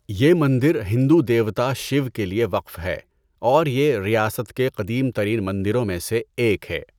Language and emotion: Urdu, neutral